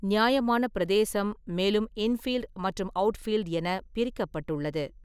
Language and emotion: Tamil, neutral